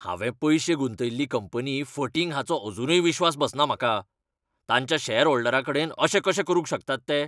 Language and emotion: Goan Konkani, angry